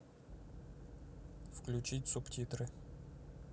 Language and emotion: Russian, neutral